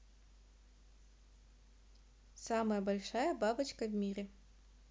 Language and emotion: Russian, neutral